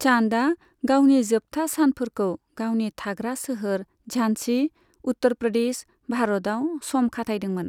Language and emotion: Bodo, neutral